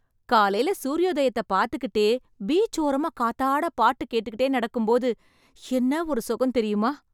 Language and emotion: Tamil, happy